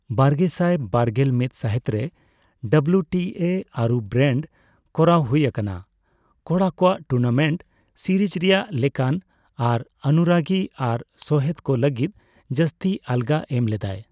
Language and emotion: Santali, neutral